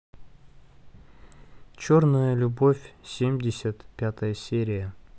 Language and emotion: Russian, neutral